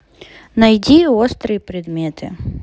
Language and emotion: Russian, neutral